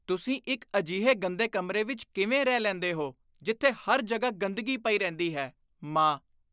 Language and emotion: Punjabi, disgusted